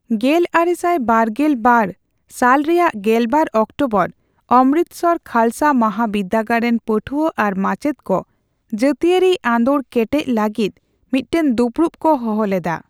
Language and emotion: Santali, neutral